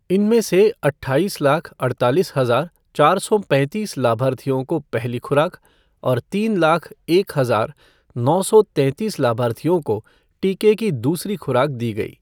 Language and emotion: Hindi, neutral